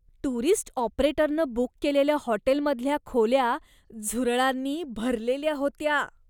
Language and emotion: Marathi, disgusted